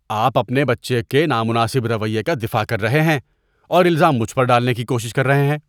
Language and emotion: Urdu, disgusted